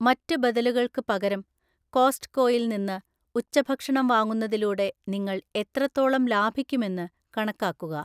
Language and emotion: Malayalam, neutral